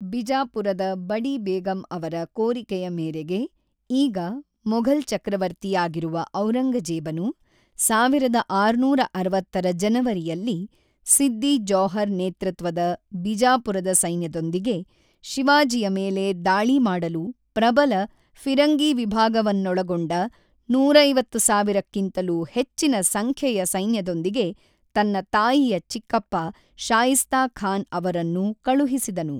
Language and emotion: Kannada, neutral